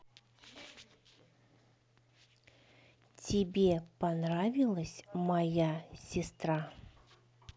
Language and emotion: Russian, neutral